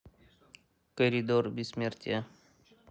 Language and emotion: Russian, neutral